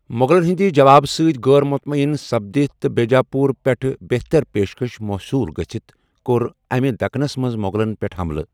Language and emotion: Kashmiri, neutral